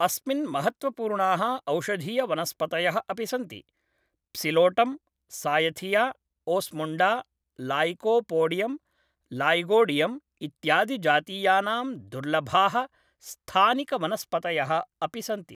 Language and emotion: Sanskrit, neutral